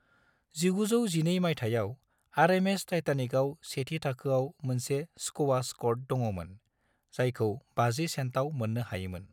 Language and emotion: Bodo, neutral